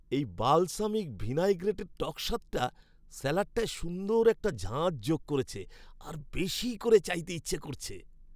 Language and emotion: Bengali, happy